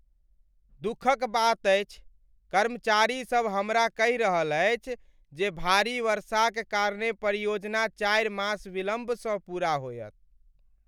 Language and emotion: Maithili, sad